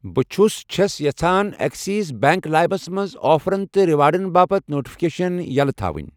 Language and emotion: Kashmiri, neutral